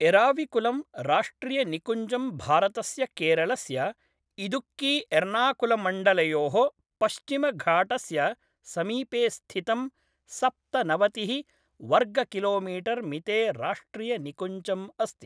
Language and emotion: Sanskrit, neutral